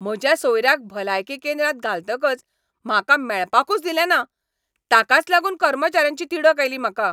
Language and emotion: Goan Konkani, angry